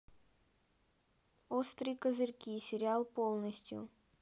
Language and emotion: Russian, neutral